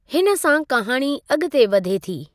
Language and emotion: Sindhi, neutral